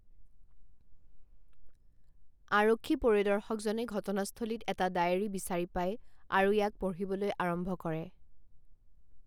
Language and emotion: Assamese, neutral